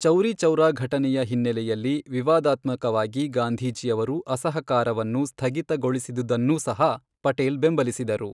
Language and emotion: Kannada, neutral